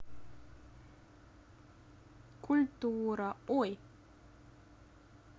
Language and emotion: Russian, neutral